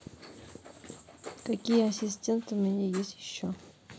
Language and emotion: Russian, neutral